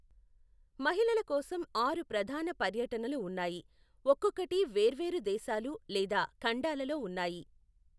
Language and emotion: Telugu, neutral